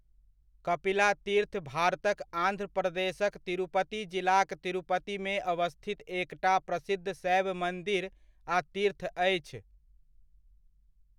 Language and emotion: Maithili, neutral